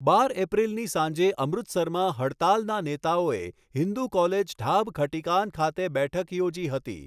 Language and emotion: Gujarati, neutral